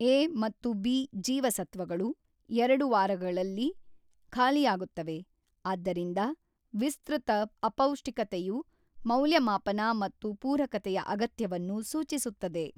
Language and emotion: Kannada, neutral